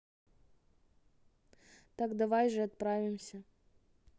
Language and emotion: Russian, neutral